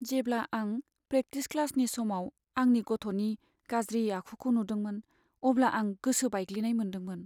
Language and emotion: Bodo, sad